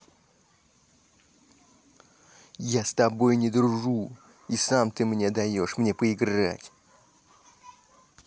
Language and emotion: Russian, angry